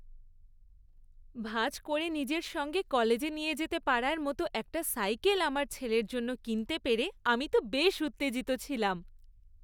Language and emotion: Bengali, happy